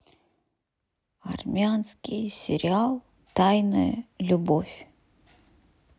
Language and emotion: Russian, sad